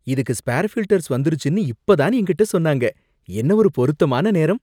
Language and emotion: Tamil, surprised